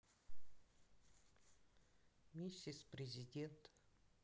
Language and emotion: Russian, sad